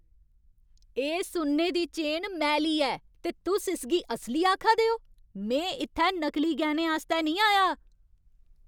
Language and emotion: Dogri, angry